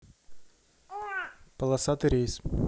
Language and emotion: Russian, neutral